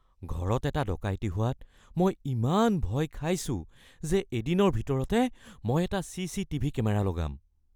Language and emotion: Assamese, fearful